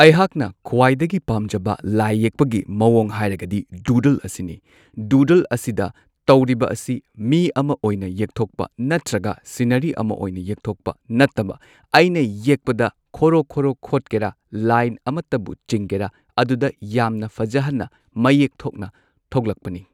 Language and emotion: Manipuri, neutral